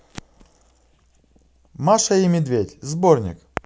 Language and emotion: Russian, positive